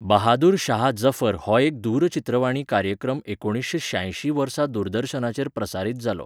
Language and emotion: Goan Konkani, neutral